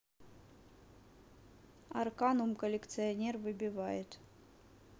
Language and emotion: Russian, neutral